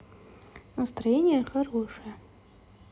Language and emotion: Russian, positive